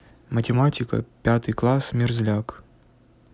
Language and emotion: Russian, neutral